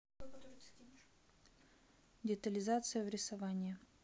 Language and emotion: Russian, neutral